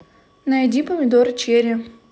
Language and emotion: Russian, neutral